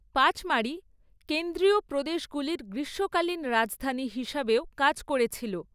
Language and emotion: Bengali, neutral